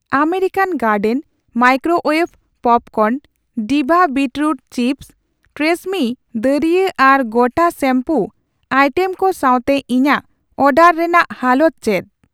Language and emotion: Santali, neutral